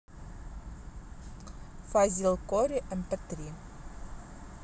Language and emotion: Russian, neutral